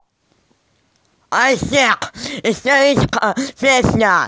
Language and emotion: Russian, angry